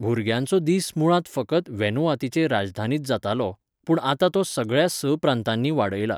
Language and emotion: Goan Konkani, neutral